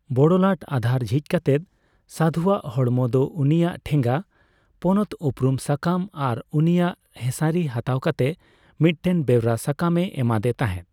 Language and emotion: Santali, neutral